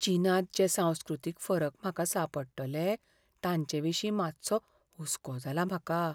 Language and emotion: Goan Konkani, fearful